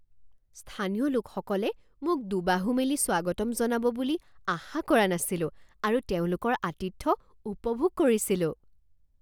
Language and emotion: Assamese, surprised